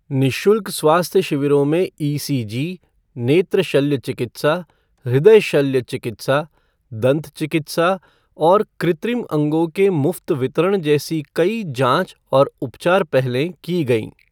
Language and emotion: Hindi, neutral